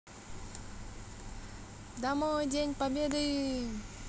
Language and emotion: Russian, positive